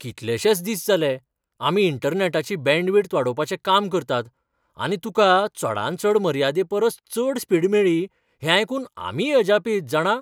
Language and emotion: Goan Konkani, surprised